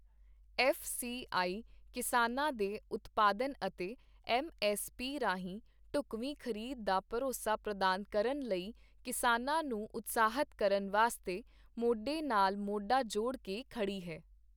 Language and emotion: Punjabi, neutral